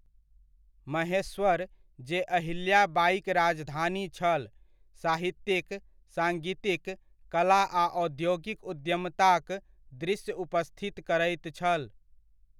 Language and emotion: Maithili, neutral